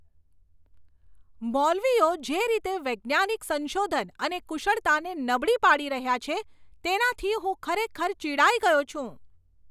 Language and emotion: Gujarati, angry